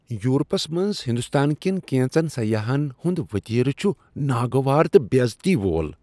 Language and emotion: Kashmiri, disgusted